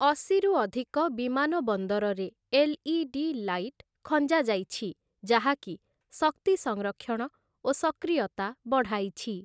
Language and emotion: Odia, neutral